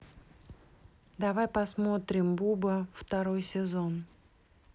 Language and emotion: Russian, neutral